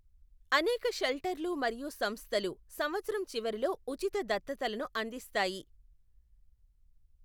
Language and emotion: Telugu, neutral